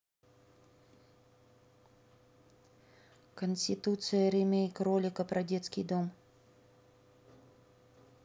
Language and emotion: Russian, neutral